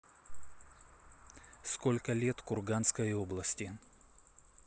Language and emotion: Russian, neutral